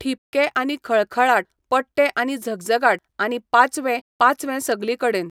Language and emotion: Goan Konkani, neutral